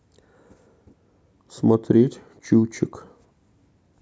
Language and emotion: Russian, neutral